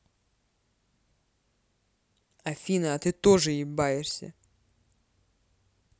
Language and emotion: Russian, angry